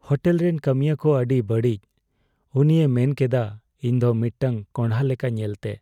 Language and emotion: Santali, sad